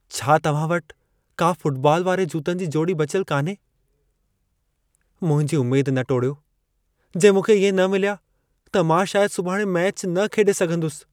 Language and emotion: Sindhi, sad